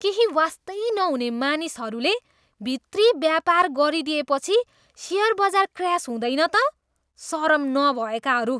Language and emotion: Nepali, disgusted